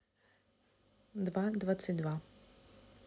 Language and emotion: Russian, neutral